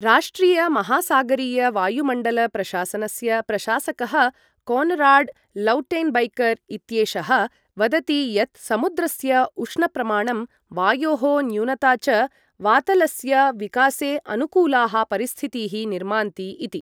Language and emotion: Sanskrit, neutral